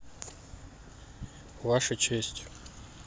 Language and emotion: Russian, neutral